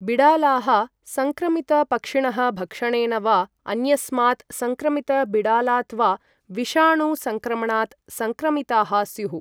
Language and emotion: Sanskrit, neutral